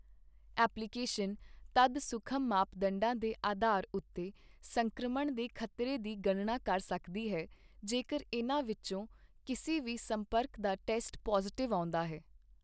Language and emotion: Punjabi, neutral